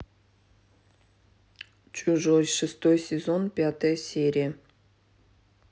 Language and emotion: Russian, neutral